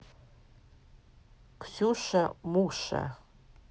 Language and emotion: Russian, neutral